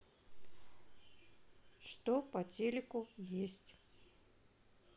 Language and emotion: Russian, neutral